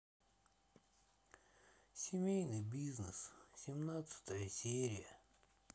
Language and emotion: Russian, sad